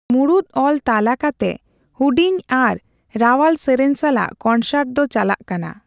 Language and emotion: Santali, neutral